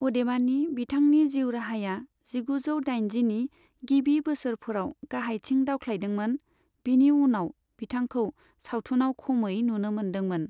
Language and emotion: Bodo, neutral